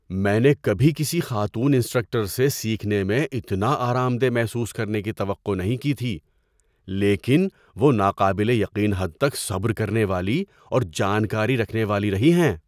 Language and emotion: Urdu, surprised